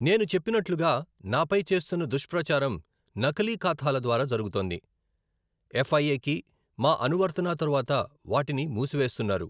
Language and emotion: Telugu, neutral